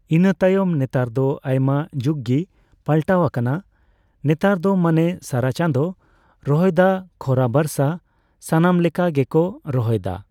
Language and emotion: Santali, neutral